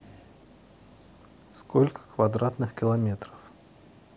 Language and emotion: Russian, neutral